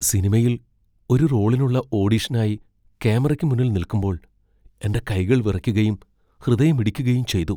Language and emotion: Malayalam, fearful